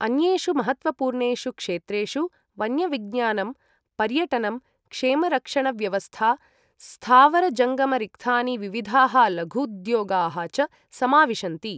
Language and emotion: Sanskrit, neutral